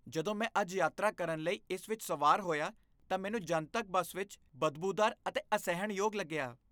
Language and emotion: Punjabi, disgusted